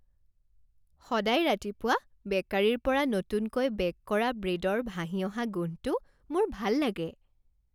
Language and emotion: Assamese, happy